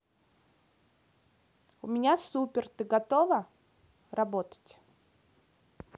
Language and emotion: Russian, positive